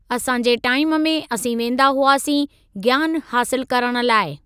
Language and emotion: Sindhi, neutral